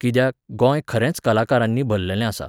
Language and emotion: Goan Konkani, neutral